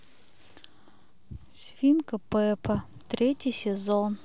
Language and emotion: Russian, neutral